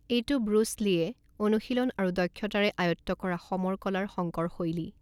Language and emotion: Assamese, neutral